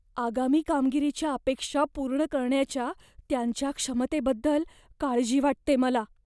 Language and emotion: Marathi, fearful